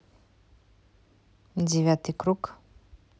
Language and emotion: Russian, neutral